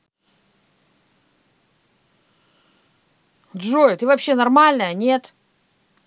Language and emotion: Russian, angry